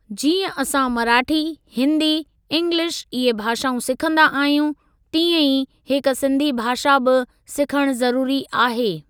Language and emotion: Sindhi, neutral